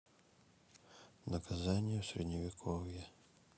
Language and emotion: Russian, neutral